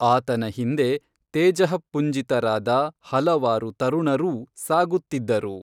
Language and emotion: Kannada, neutral